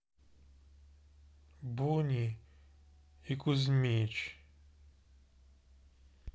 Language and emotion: Russian, sad